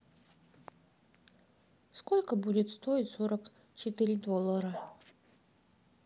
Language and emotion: Russian, sad